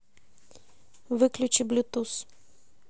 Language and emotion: Russian, neutral